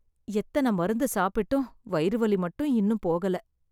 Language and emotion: Tamil, sad